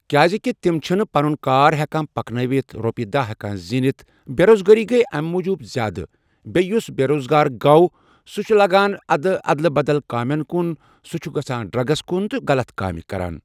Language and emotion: Kashmiri, neutral